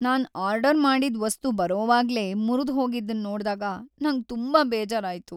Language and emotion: Kannada, sad